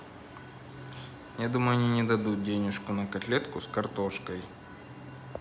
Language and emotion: Russian, neutral